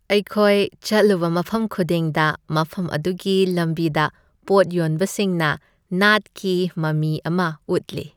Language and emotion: Manipuri, happy